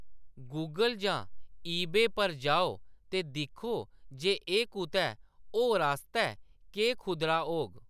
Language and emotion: Dogri, neutral